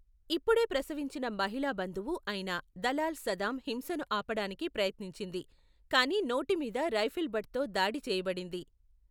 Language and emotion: Telugu, neutral